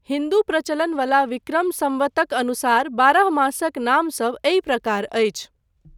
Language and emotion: Maithili, neutral